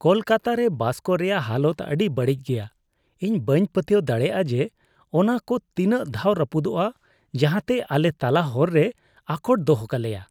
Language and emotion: Santali, disgusted